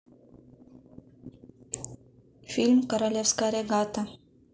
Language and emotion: Russian, neutral